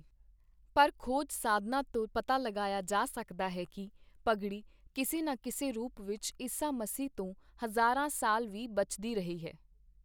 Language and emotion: Punjabi, neutral